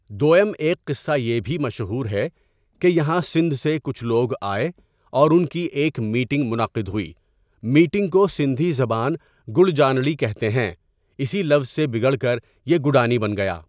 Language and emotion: Urdu, neutral